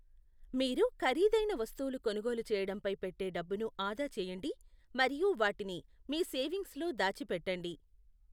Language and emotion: Telugu, neutral